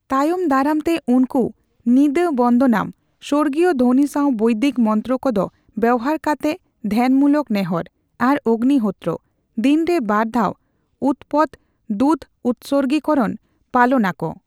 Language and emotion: Santali, neutral